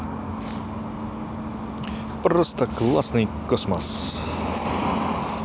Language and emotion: Russian, positive